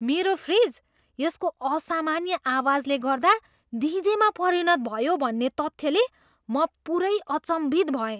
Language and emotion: Nepali, surprised